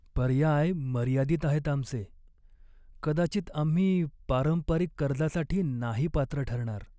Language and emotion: Marathi, sad